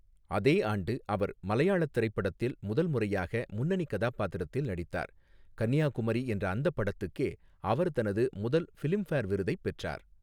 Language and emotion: Tamil, neutral